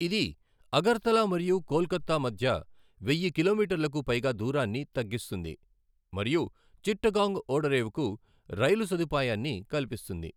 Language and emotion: Telugu, neutral